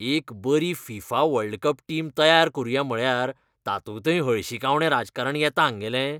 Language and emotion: Goan Konkani, disgusted